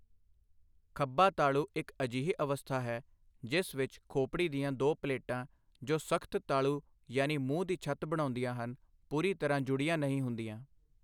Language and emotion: Punjabi, neutral